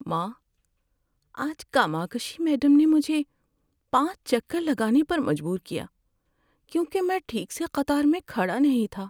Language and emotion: Urdu, sad